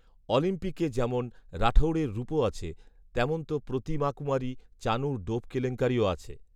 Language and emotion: Bengali, neutral